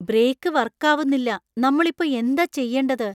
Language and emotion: Malayalam, fearful